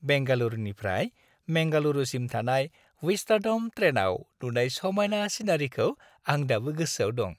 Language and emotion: Bodo, happy